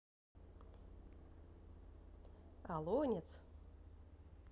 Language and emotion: Russian, positive